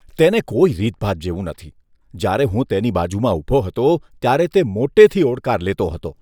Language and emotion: Gujarati, disgusted